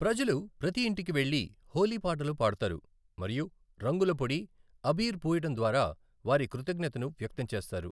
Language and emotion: Telugu, neutral